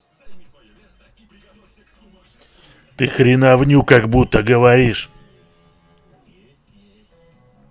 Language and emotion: Russian, angry